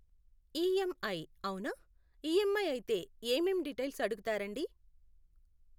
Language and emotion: Telugu, neutral